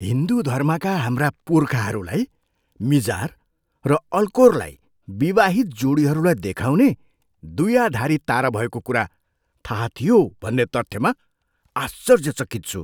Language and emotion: Nepali, surprised